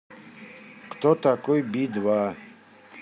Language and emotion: Russian, neutral